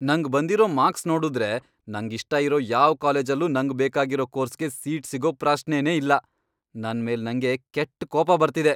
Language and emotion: Kannada, angry